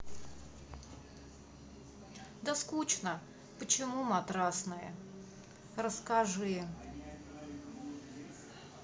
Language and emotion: Russian, sad